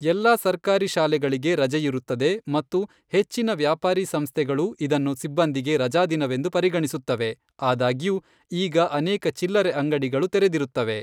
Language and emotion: Kannada, neutral